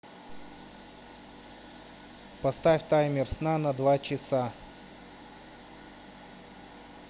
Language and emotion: Russian, neutral